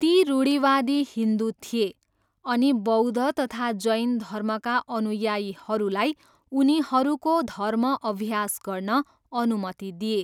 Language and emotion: Nepali, neutral